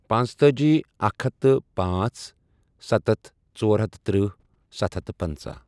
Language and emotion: Kashmiri, neutral